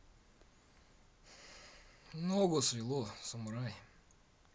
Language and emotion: Russian, neutral